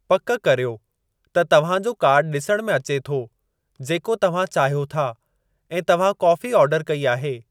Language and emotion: Sindhi, neutral